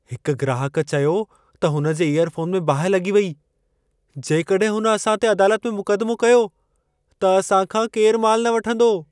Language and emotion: Sindhi, fearful